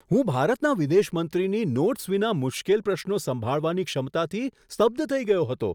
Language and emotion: Gujarati, surprised